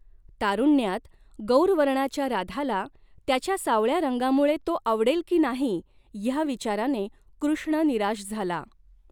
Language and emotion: Marathi, neutral